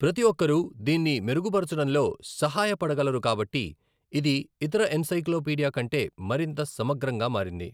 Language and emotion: Telugu, neutral